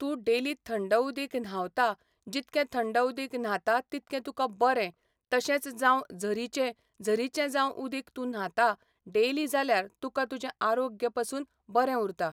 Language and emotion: Goan Konkani, neutral